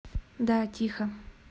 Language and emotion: Russian, neutral